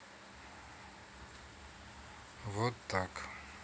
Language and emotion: Russian, sad